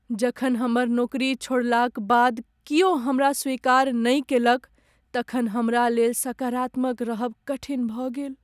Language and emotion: Maithili, sad